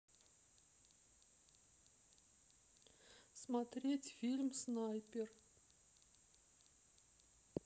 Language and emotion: Russian, neutral